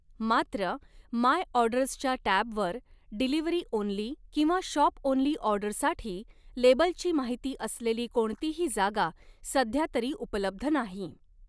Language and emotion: Marathi, neutral